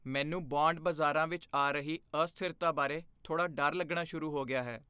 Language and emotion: Punjabi, fearful